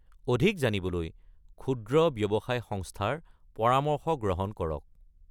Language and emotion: Assamese, neutral